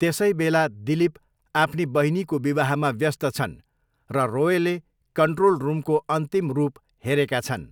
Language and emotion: Nepali, neutral